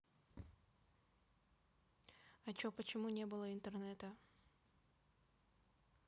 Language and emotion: Russian, neutral